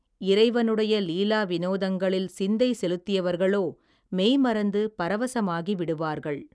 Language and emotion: Tamil, neutral